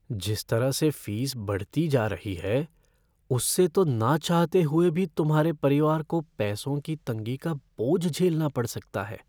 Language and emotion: Hindi, fearful